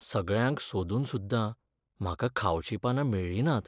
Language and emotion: Goan Konkani, sad